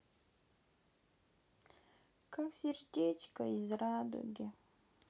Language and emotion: Russian, sad